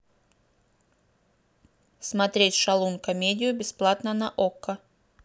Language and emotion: Russian, neutral